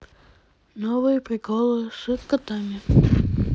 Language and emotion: Russian, neutral